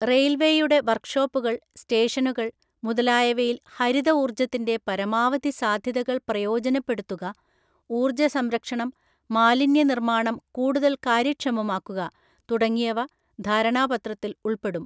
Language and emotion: Malayalam, neutral